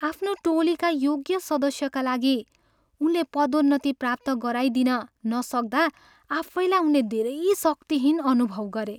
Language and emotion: Nepali, sad